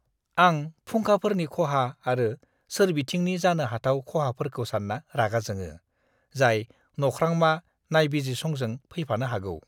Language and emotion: Bodo, disgusted